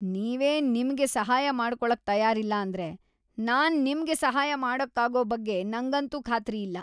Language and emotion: Kannada, disgusted